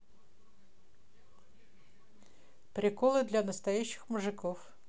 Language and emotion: Russian, neutral